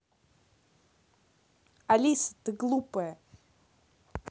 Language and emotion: Russian, angry